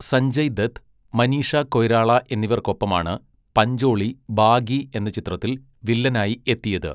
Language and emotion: Malayalam, neutral